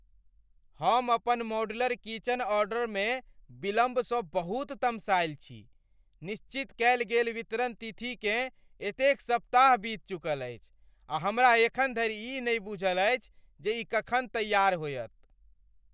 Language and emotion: Maithili, angry